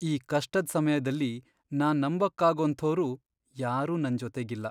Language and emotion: Kannada, sad